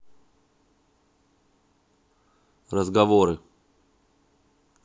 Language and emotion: Russian, neutral